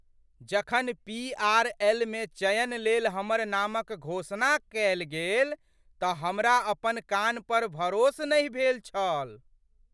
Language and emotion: Maithili, surprised